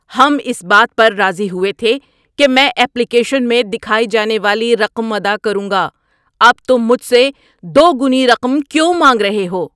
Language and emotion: Urdu, angry